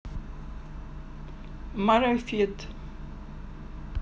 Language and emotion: Russian, neutral